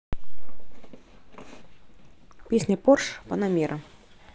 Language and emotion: Russian, neutral